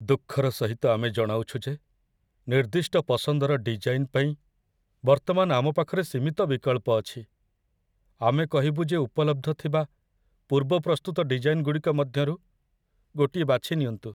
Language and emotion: Odia, sad